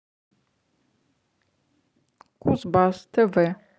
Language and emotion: Russian, neutral